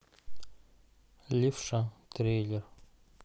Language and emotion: Russian, neutral